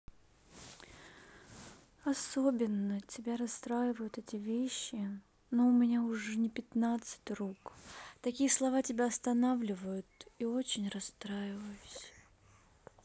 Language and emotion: Russian, sad